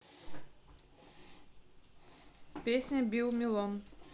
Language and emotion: Russian, neutral